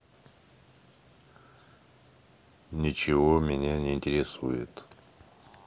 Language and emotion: Russian, neutral